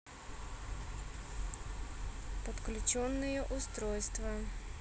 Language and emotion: Russian, neutral